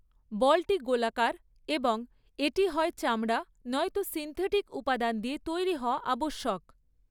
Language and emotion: Bengali, neutral